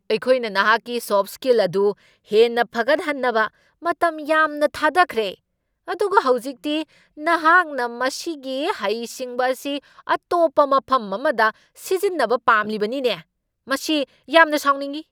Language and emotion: Manipuri, angry